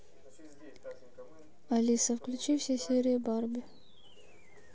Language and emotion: Russian, neutral